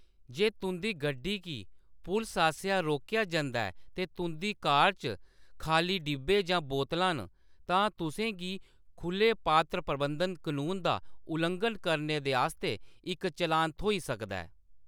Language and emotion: Dogri, neutral